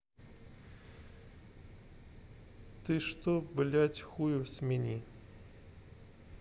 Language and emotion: Russian, neutral